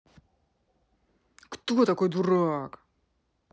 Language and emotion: Russian, angry